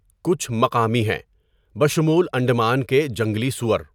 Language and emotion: Urdu, neutral